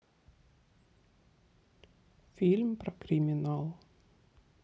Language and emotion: Russian, sad